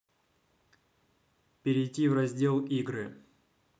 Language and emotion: Russian, neutral